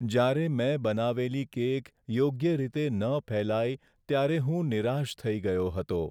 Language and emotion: Gujarati, sad